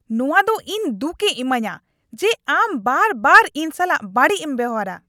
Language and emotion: Santali, angry